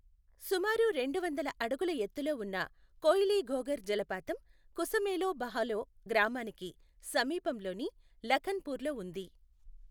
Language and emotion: Telugu, neutral